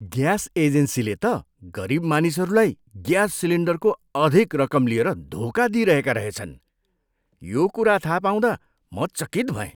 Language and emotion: Nepali, disgusted